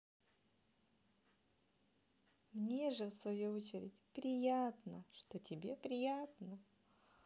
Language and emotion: Russian, positive